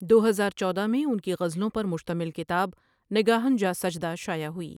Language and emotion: Urdu, neutral